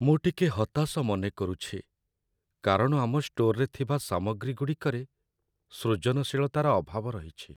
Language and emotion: Odia, sad